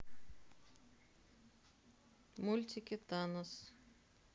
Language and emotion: Russian, neutral